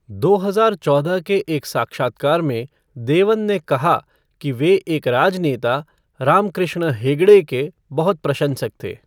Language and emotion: Hindi, neutral